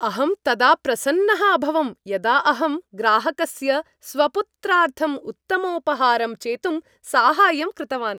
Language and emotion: Sanskrit, happy